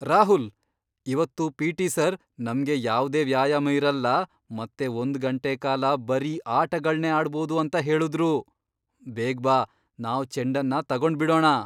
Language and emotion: Kannada, surprised